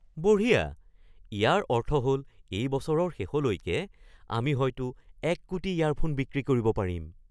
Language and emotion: Assamese, surprised